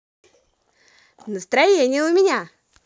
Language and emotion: Russian, positive